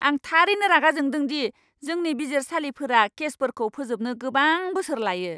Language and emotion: Bodo, angry